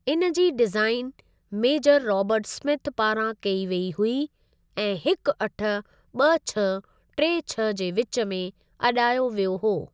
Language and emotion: Sindhi, neutral